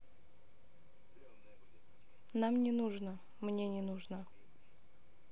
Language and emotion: Russian, neutral